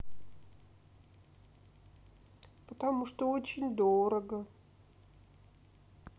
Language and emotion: Russian, sad